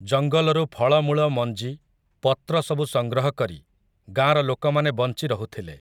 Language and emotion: Odia, neutral